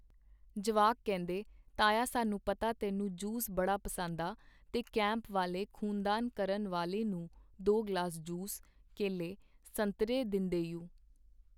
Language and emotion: Punjabi, neutral